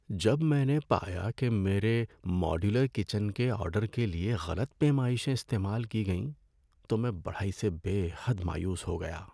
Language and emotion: Urdu, sad